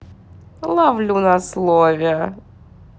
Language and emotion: Russian, positive